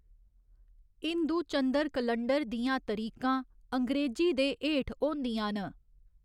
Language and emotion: Dogri, neutral